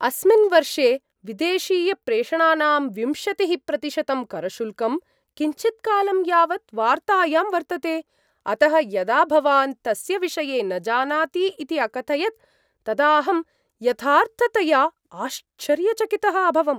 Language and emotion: Sanskrit, surprised